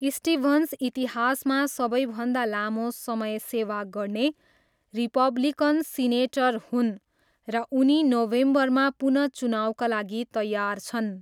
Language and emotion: Nepali, neutral